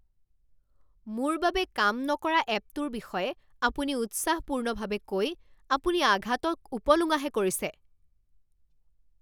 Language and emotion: Assamese, angry